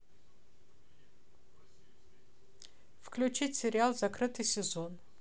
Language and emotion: Russian, neutral